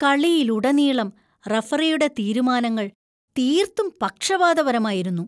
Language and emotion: Malayalam, disgusted